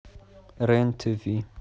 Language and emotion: Russian, neutral